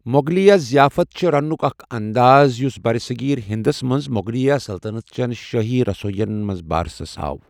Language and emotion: Kashmiri, neutral